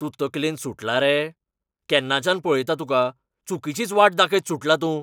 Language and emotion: Goan Konkani, angry